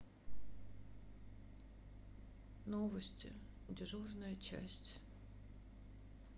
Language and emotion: Russian, sad